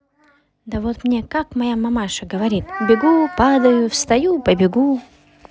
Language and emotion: Russian, positive